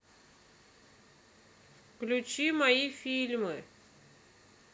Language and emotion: Russian, neutral